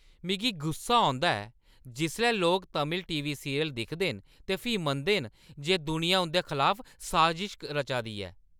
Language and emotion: Dogri, angry